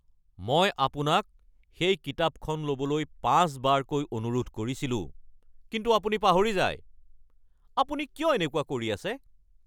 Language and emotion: Assamese, angry